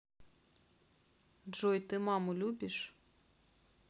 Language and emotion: Russian, neutral